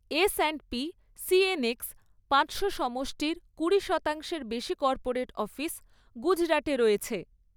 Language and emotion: Bengali, neutral